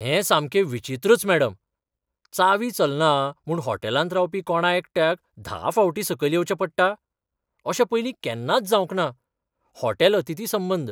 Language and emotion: Goan Konkani, surprised